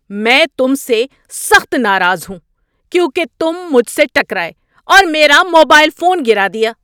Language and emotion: Urdu, angry